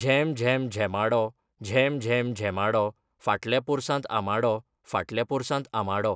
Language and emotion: Goan Konkani, neutral